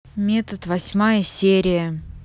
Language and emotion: Russian, neutral